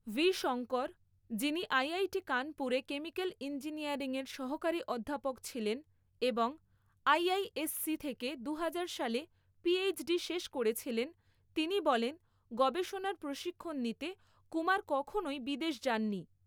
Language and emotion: Bengali, neutral